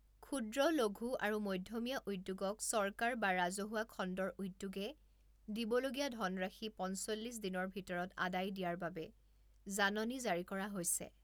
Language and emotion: Assamese, neutral